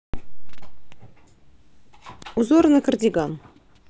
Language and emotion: Russian, neutral